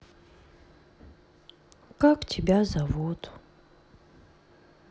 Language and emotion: Russian, sad